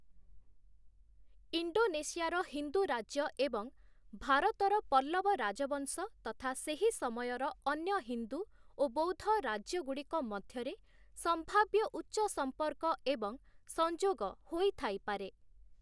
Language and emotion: Odia, neutral